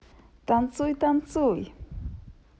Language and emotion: Russian, positive